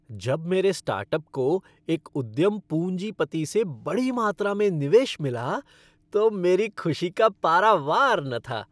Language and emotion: Hindi, happy